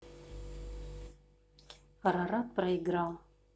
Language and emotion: Russian, neutral